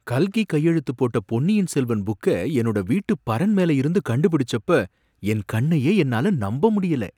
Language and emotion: Tamil, surprised